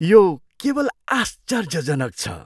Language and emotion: Nepali, surprised